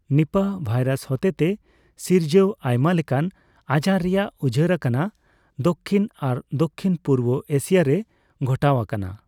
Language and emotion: Santali, neutral